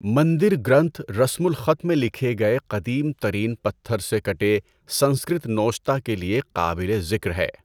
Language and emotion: Urdu, neutral